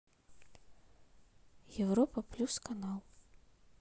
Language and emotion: Russian, neutral